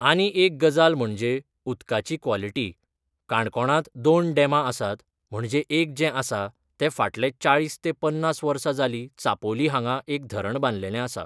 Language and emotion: Goan Konkani, neutral